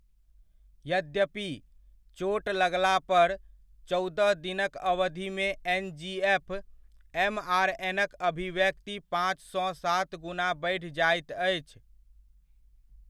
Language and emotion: Maithili, neutral